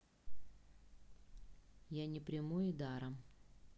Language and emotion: Russian, neutral